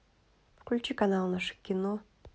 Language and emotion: Russian, neutral